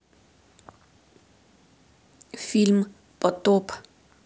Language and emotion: Russian, neutral